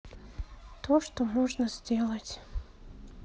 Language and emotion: Russian, sad